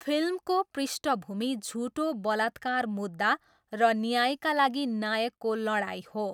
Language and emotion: Nepali, neutral